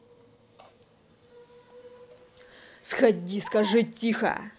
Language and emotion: Russian, angry